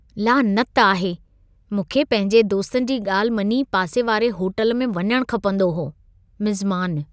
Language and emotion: Sindhi, disgusted